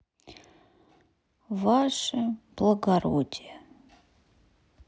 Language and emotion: Russian, sad